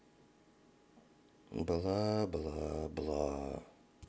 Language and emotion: Russian, sad